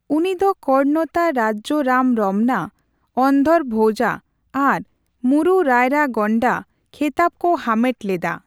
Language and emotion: Santali, neutral